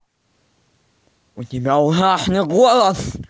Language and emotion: Russian, angry